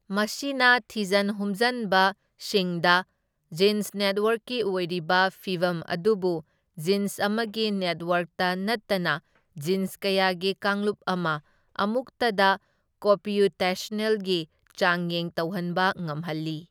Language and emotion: Manipuri, neutral